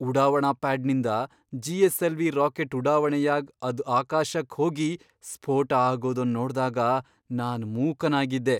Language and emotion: Kannada, surprised